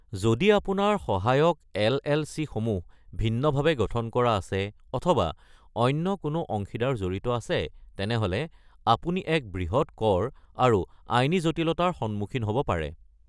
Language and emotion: Assamese, neutral